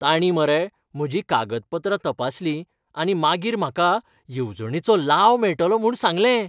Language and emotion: Goan Konkani, happy